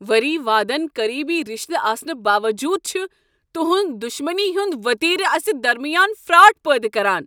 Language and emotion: Kashmiri, angry